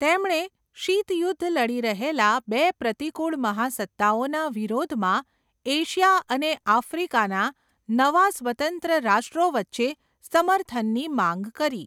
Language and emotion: Gujarati, neutral